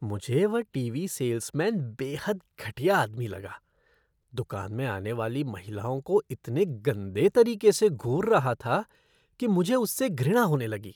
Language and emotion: Hindi, disgusted